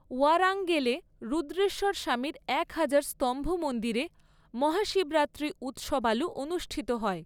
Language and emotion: Bengali, neutral